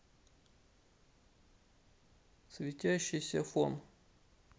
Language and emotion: Russian, neutral